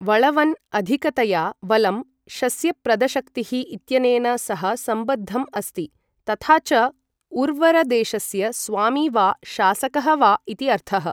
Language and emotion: Sanskrit, neutral